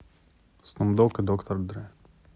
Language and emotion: Russian, neutral